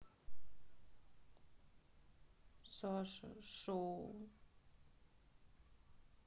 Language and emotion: Russian, sad